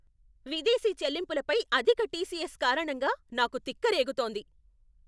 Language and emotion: Telugu, angry